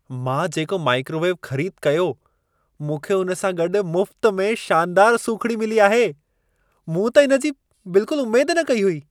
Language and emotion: Sindhi, surprised